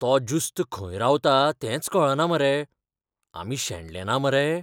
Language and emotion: Goan Konkani, fearful